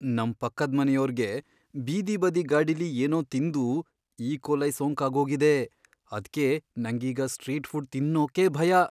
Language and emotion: Kannada, fearful